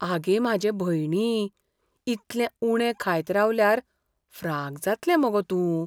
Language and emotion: Goan Konkani, fearful